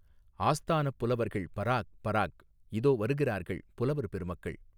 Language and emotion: Tamil, neutral